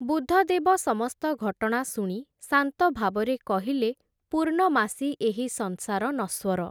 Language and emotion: Odia, neutral